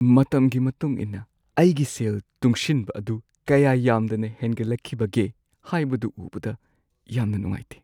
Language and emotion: Manipuri, sad